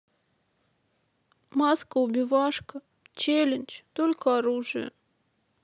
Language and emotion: Russian, sad